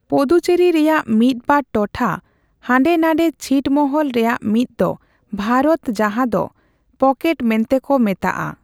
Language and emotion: Santali, neutral